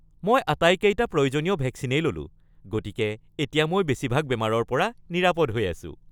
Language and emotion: Assamese, happy